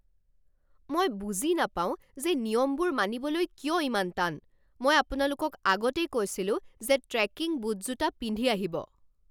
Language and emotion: Assamese, angry